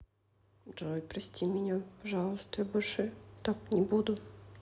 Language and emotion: Russian, sad